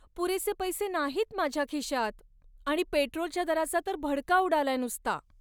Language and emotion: Marathi, sad